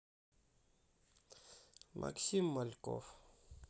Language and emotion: Russian, sad